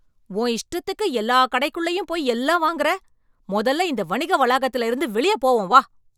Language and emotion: Tamil, angry